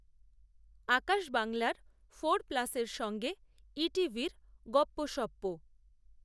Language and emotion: Bengali, neutral